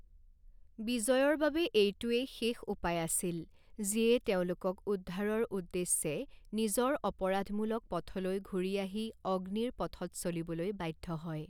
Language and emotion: Assamese, neutral